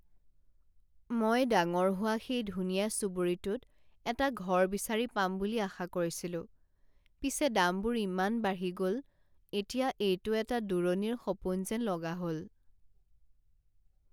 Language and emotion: Assamese, sad